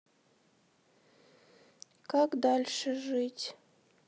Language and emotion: Russian, sad